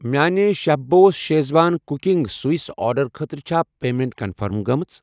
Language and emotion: Kashmiri, neutral